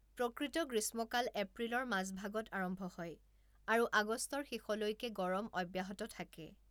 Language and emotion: Assamese, neutral